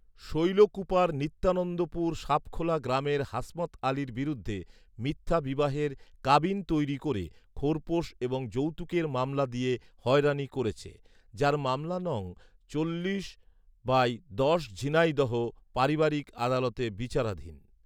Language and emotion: Bengali, neutral